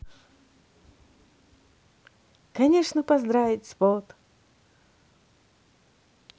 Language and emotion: Russian, positive